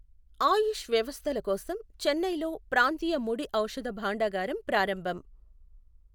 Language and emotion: Telugu, neutral